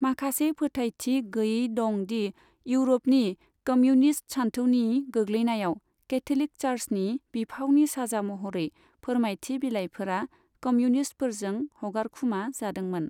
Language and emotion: Bodo, neutral